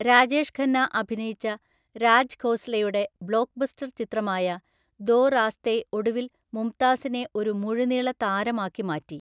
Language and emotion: Malayalam, neutral